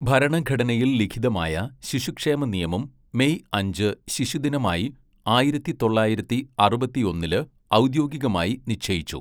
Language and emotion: Malayalam, neutral